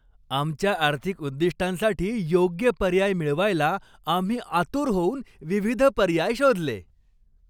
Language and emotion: Marathi, happy